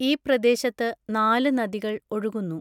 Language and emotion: Malayalam, neutral